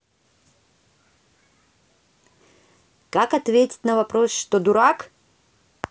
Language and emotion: Russian, neutral